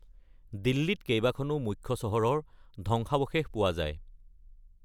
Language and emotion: Assamese, neutral